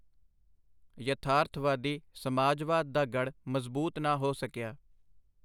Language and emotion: Punjabi, neutral